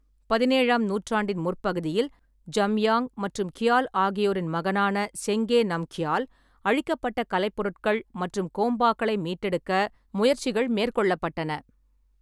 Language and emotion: Tamil, neutral